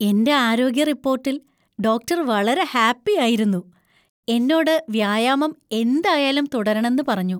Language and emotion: Malayalam, happy